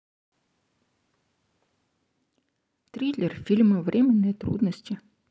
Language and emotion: Russian, neutral